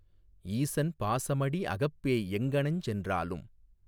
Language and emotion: Tamil, neutral